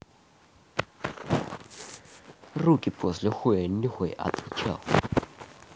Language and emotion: Russian, angry